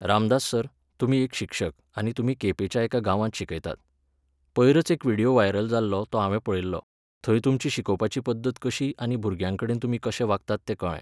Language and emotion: Goan Konkani, neutral